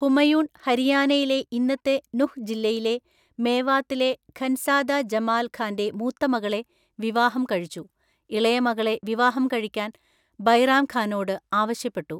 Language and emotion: Malayalam, neutral